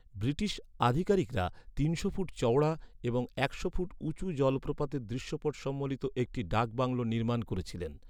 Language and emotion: Bengali, neutral